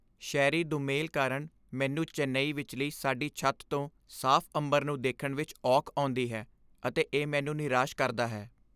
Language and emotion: Punjabi, sad